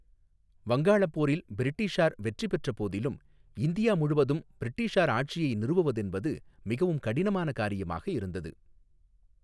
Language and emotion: Tamil, neutral